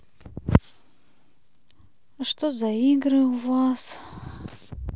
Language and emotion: Russian, sad